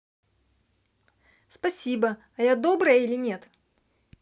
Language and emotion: Russian, positive